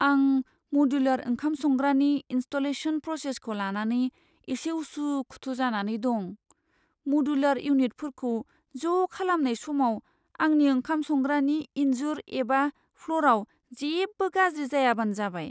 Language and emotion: Bodo, fearful